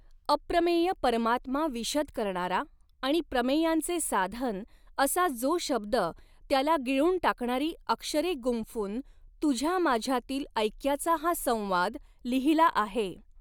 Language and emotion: Marathi, neutral